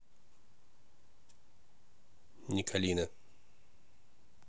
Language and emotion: Russian, neutral